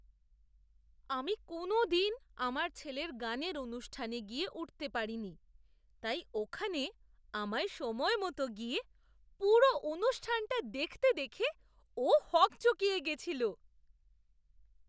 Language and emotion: Bengali, surprised